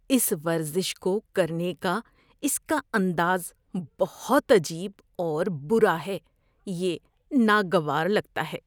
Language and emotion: Urdu, disgusted